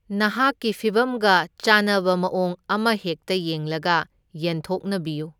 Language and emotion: Manipuri, neutral